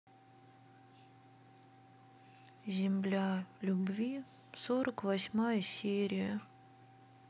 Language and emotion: Russian, sad